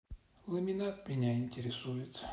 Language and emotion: Russian, sad